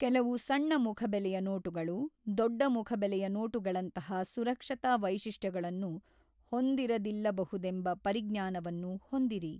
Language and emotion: Kannada, neutral